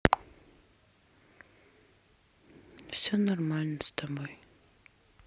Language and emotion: Russian, sad